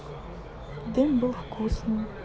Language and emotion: Russian, sad